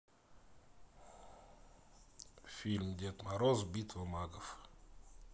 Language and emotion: Russian, neutral